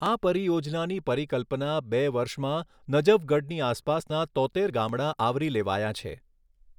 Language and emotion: Gujarati, neutral